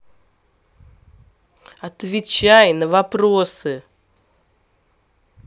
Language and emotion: Russian, angry